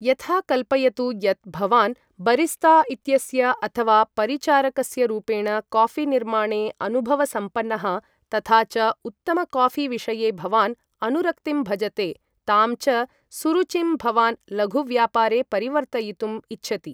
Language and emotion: Sanskrit, neutral